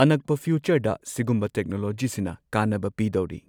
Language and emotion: Manipuri, neutral